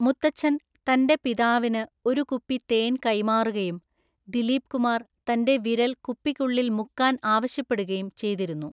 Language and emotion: Malayalam, neutral